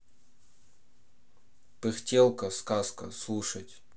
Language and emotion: Russian, neutral